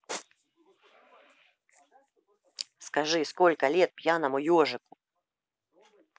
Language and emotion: Russian, neutral